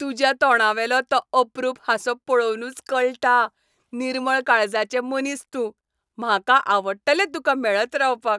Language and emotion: Goan Konkani, happy